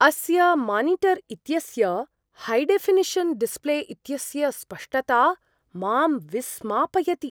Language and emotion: Sanskrit, surprised